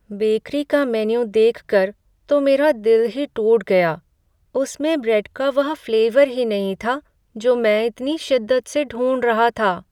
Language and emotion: Hindi, sad